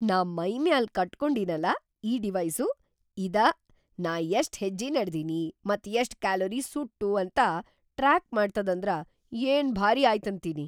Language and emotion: Kannada, surprised